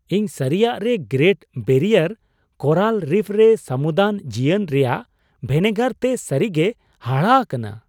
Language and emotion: Santali, surprised